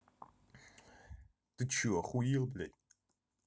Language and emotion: Russian, angry